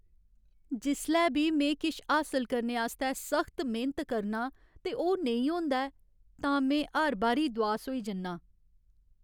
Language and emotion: Dogri, sad